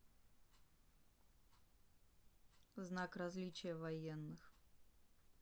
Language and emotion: Russian, neutral